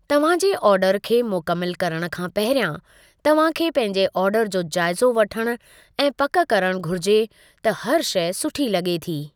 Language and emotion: Sindhi, neutral